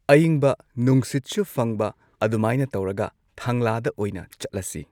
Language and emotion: Manipuri, neutral